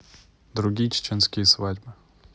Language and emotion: Russian, neutral